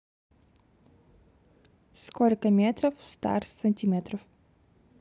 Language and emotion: Russian, neutral